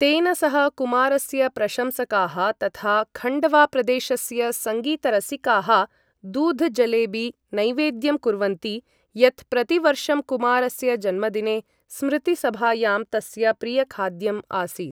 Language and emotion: Sanskrit, neutral